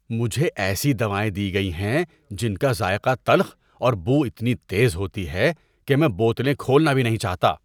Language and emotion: Urdu, disgusted